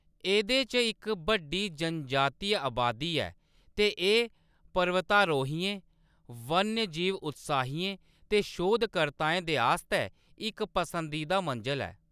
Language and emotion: Dogri, neutral